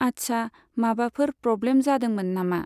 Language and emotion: Bodo, neutral